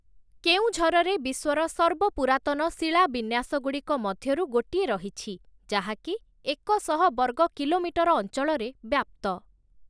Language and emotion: Odia, neutral